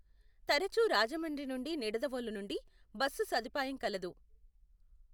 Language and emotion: Telugu, neutral